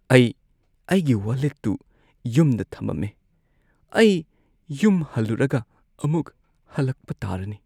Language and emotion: Manipuri, sad